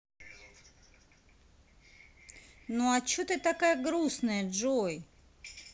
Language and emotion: Russian, neutral